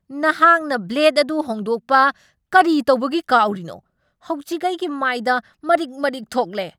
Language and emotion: Manipuri, angry